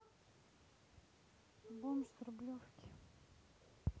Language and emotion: Russian, neutral